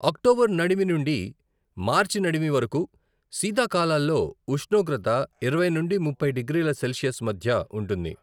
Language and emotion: Telugu, neutral